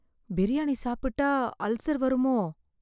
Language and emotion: Tamil, fearful